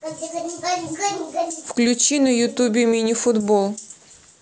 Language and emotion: Russian, neutral